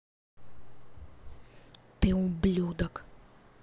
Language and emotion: Russian, angry